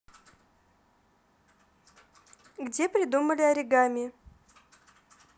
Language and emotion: Russian, neutral